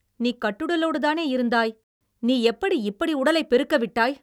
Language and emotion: Tamil, angry